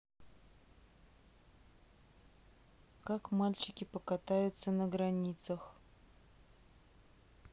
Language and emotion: Russian, neutral